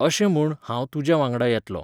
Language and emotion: Goan Konkani, neutral